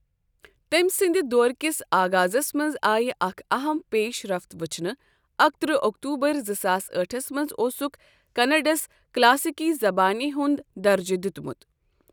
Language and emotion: Kashmiri, neutral